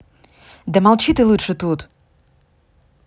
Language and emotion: Russian, angry